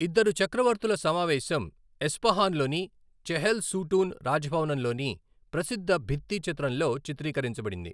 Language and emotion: Telugu, neutral